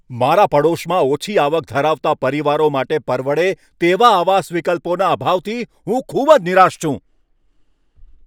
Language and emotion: Gujarati, angry